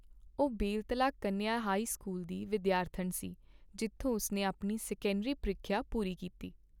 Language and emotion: Punjabi, neutral